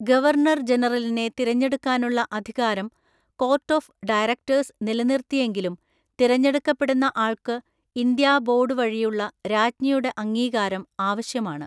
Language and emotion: Malayalam, neutral